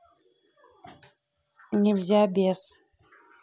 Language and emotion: Russian, neutral